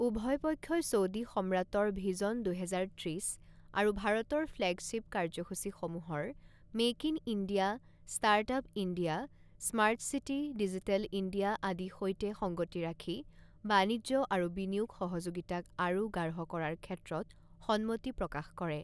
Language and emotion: Assamese, neutral